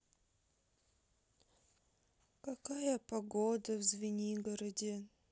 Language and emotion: Russian, sad